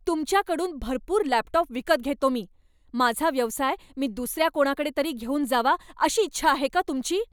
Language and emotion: Marathi, angry